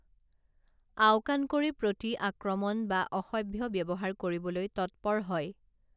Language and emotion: Assamese, neutral